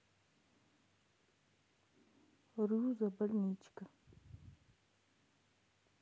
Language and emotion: Russian, sad